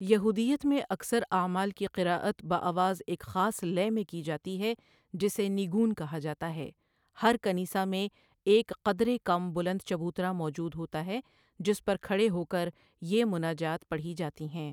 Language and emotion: Urdu, neutral